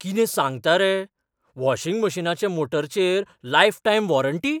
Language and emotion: Goan Konkani, surprised